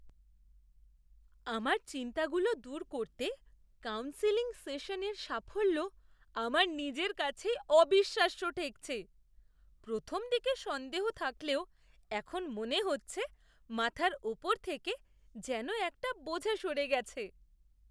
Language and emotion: Bengali, surprised